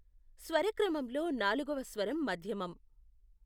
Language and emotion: Telugu, neutral